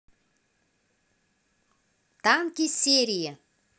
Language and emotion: Russian, positive